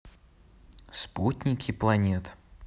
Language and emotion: Russian, neutral